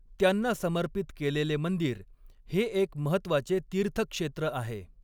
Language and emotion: Marathi, neutral